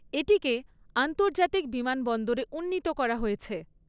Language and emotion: Bengali, neutral